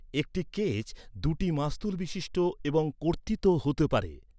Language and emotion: Bengali, neutral